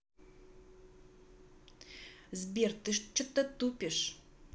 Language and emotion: Russian, angry